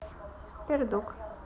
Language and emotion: Russian, neutral